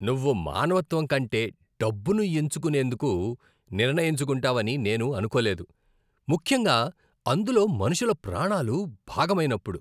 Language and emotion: Telugu, disgusted